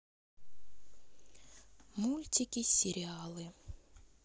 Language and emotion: Russian, neutral